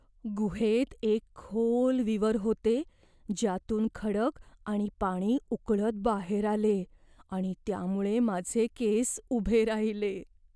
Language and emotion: Marathi, fearful